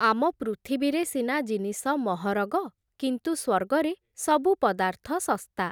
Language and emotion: Odia, neutral